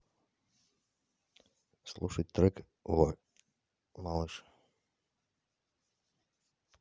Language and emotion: Russian, neutral